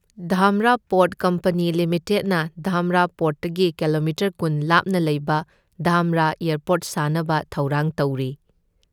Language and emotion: Manipuri, neutral